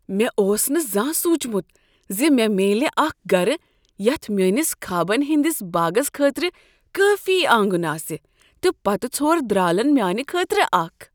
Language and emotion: Kashmiri, surprised